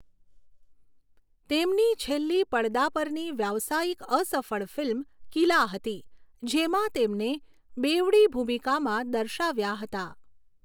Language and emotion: Gujarati, neutral